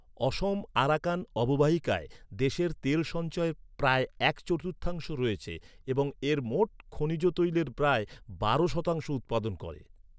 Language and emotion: Bengali, neutral